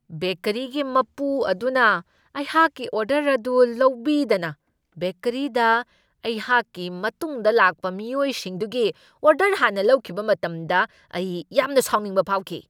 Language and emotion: Manipuri, angry